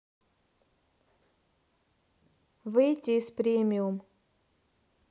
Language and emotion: Russian, neutral